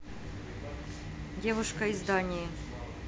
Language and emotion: Russian, neutral